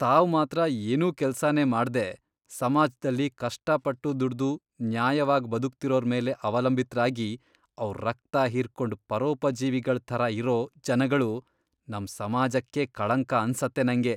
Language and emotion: Kannada, disgusted